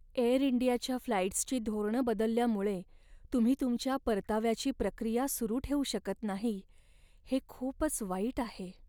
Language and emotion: Marathi, sad